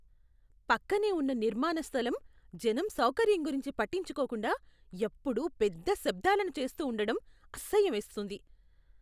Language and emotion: Telugu, disgusted